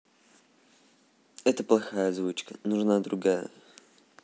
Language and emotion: Russian, neutral